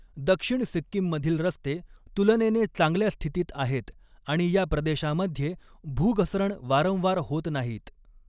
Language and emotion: Marathi, neutral